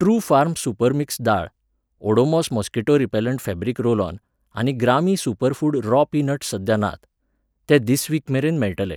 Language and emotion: Goan Konkani, neutral